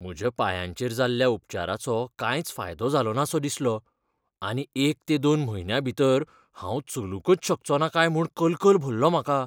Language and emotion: Goan Konkani, fearful